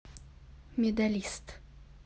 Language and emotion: Russian, neutral